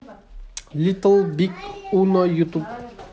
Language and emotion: Russian, neutral